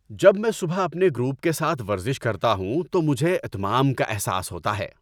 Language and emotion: Urdu, happy